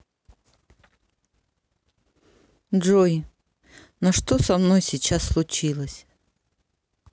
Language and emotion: Russian, sad